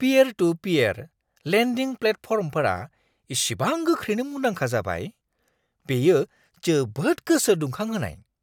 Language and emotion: Bodo, surprised